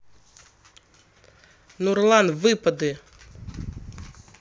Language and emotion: Russian, neutral